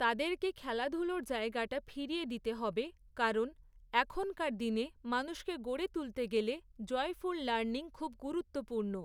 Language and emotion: Bengali, neutral